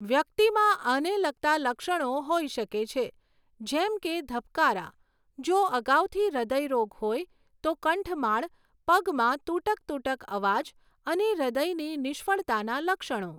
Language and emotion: Gujarati, neutral